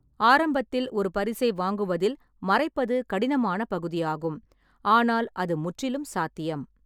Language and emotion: Tamil, neutral